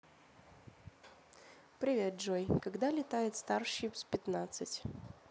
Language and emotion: Russian, neutral